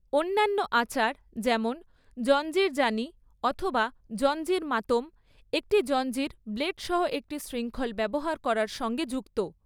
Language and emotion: Bengali, neutral